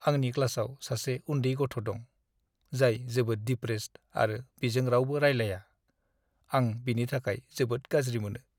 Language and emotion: Bodo, sad